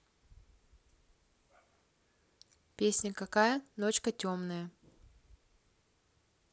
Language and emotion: Russian, neutral